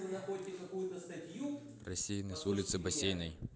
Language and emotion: Russian, neutral